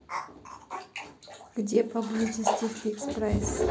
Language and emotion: Russian, neutral